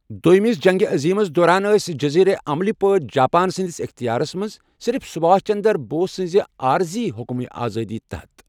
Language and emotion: Kashmiri, neutral